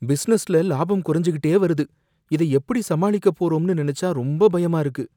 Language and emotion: Tamil, fearful